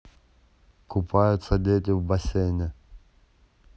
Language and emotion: Russian, neutral